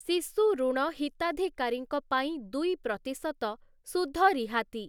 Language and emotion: Odia, neutral